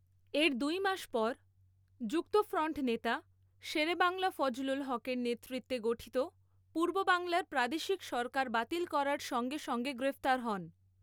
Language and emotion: Bengali, neutral